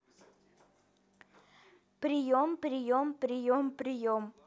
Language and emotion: Russian, neutral